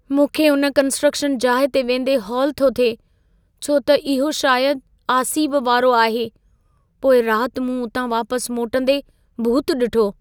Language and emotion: Sindhi, fearful